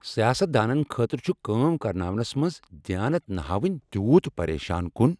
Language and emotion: Kashmiri, angry